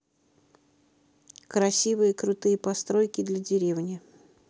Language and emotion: Russian, neutral